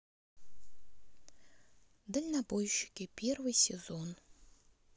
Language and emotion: Russian, neutral